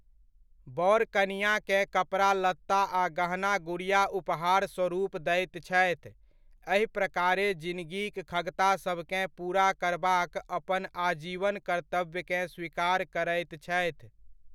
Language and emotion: Maithili, neutral